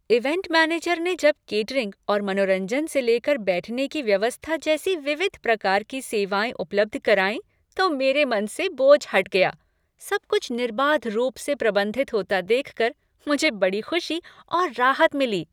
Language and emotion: Hindi, happy